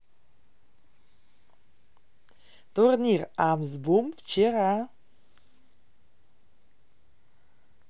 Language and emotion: Russian, positive